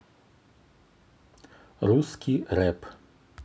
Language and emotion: Russian, neutral